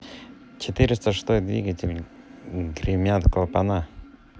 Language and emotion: Russian, neutral